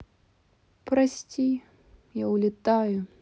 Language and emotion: Russian, sad